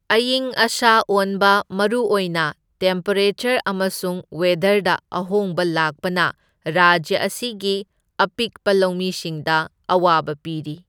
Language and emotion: Manipuri, neutral